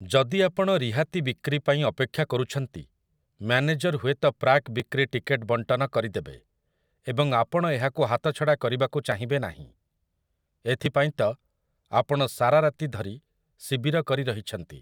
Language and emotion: Odia, neutral